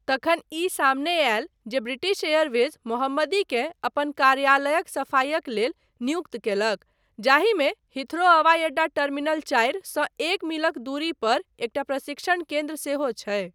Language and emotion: Maithili, neutral